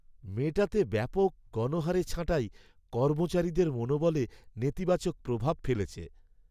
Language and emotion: Bengali, sad